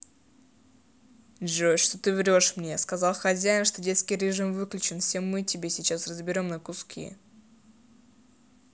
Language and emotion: Russian, angry